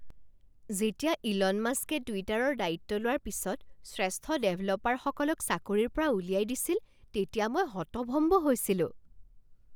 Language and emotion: Assamese, surprised